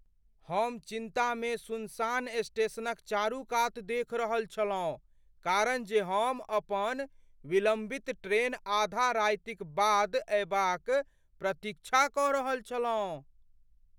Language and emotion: Maithili, fearful